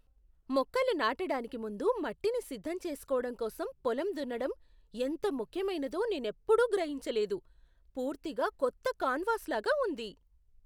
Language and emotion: Telugu, surprised